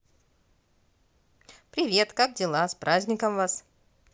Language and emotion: Russian, positive